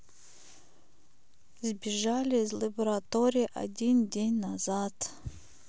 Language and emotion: Russian, sad